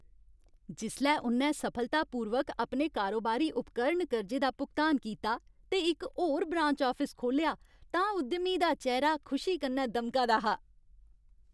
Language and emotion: Dogri, happy